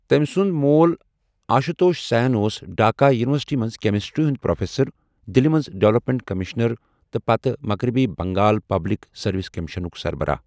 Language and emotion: Kashmiri, neutral